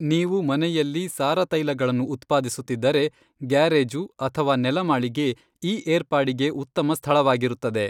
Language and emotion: Kannada, neutral